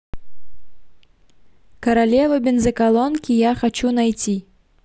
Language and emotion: Russian, neutral